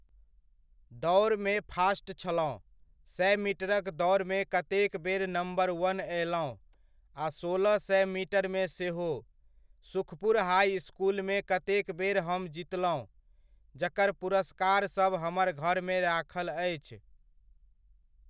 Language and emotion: Maithili, neutral